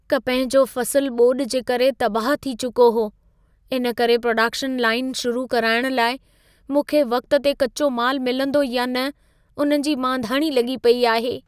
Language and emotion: Sindhi, fearful